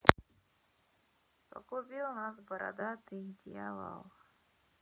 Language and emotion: Russian, sad